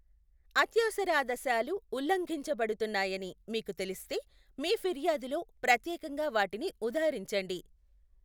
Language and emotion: Telugu, neutral